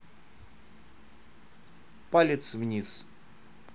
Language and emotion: Russian, neutral